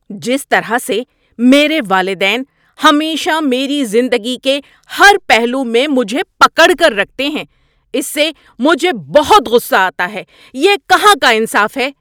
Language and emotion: Urdu, angry